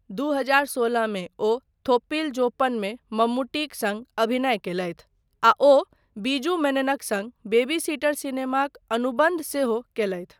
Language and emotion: Maithili, neutral